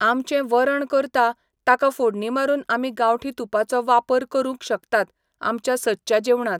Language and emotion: Goan Konkani, neutral